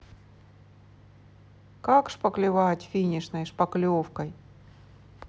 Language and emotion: Russian, neutral